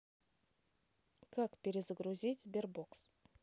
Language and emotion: Russian, neutral